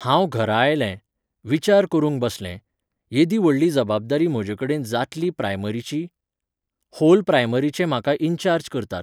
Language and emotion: Goan Konkani, neutral